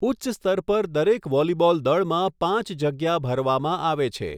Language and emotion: Gujarati, neutral